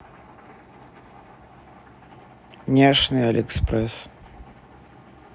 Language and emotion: Russian, neutral